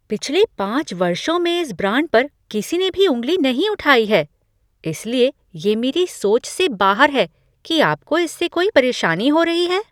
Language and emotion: Hindi, surprised